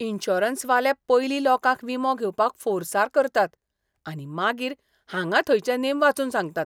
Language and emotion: Goan Konkani, disgusted